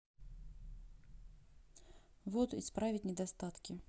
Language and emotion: Russian, sad